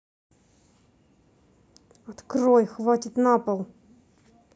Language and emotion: Russian, angry